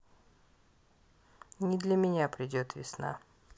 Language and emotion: Russian, neutral